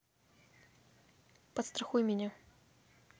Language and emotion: Russian, neutral